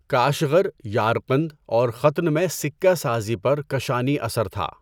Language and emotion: Urdu, neutral